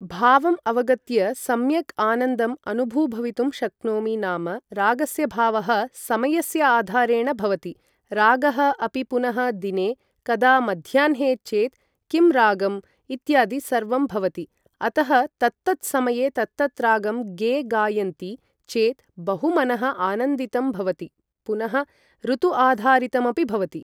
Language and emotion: Sanskrit, neutral